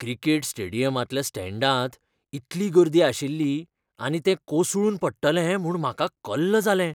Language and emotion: Goan Konkani, fearful